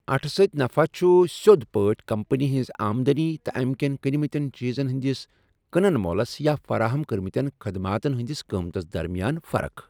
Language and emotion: Kashmiri, neutral